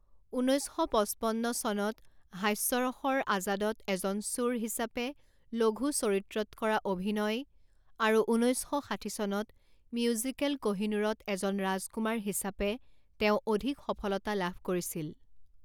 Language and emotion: Assamese, neutral